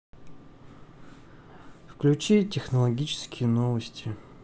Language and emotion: Russian, sad